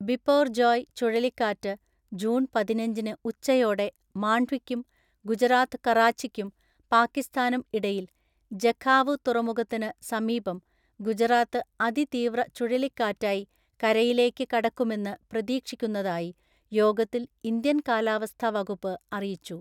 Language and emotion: Malayalam, neutral